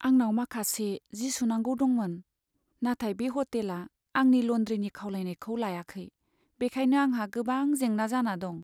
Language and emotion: Bodo, sad